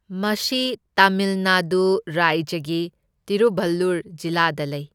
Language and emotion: Manipuri, neutral